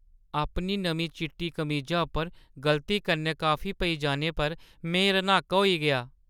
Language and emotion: Dogri, sad